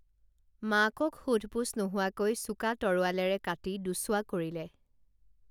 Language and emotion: Assamese, neutral